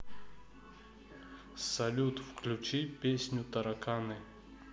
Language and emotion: Russian, neutral